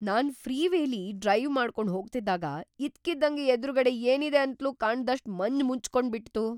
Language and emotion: Kannada, surprised